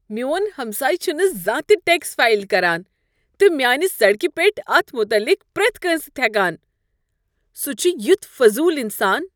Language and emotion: Kashmiri, disgusted